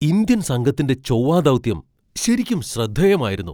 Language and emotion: Malayalam, surprised